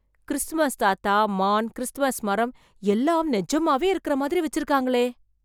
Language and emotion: Tamil, surprised